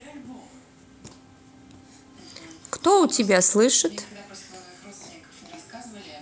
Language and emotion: Russian, neutral